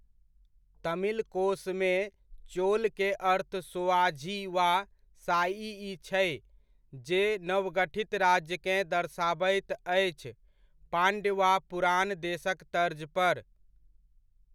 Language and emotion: Maithili, neutral